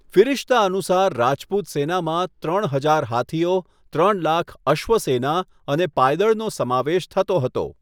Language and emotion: Gujarati, neutral